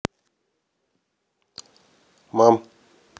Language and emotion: Russian, neutral